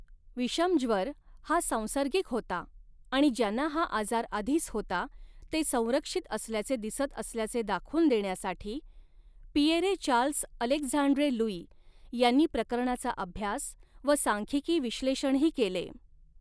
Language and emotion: Marathi, neutral